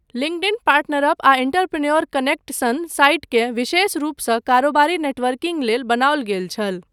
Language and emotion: Maithili, neutral